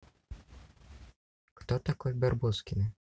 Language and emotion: Russian, neutral